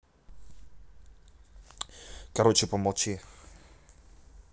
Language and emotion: Russian, angry